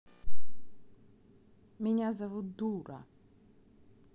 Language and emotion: Russian, neutral